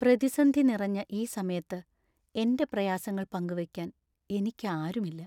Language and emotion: Malayalam, sad